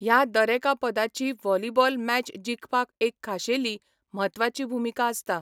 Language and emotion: Goan Konkani, neutral